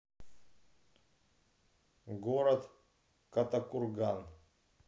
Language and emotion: Russian, neutral